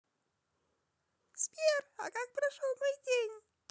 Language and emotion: Russian, positive